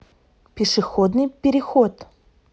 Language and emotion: Russian, neutral